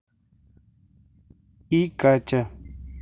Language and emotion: Russian, neutral